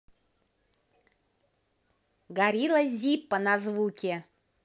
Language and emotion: Russian, positive